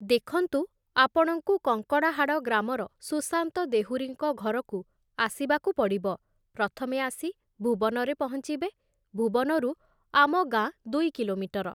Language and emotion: Odia, neutral